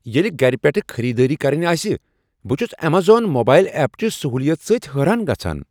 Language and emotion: Kashmiri, surprised